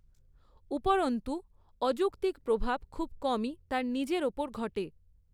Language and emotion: Bengali, neutral